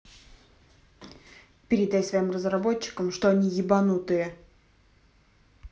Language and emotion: Russian, angry